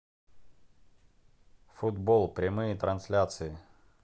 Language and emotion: Russian, neutral